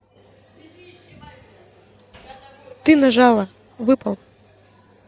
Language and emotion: Russian, neutral